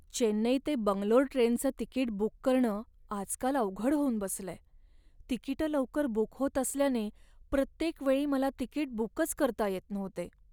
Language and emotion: Marathi, sad